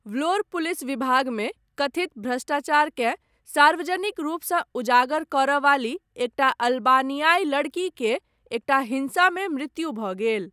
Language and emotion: Maithili, neutral